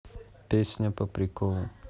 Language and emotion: Russian, neutral